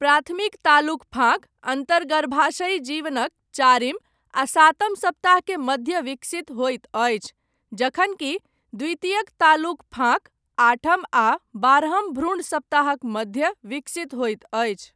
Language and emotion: Maithili, neutral